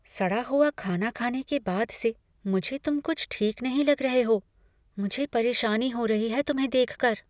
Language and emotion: Hindi, fearful